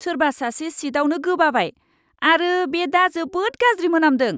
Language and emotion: Bodo, disgusted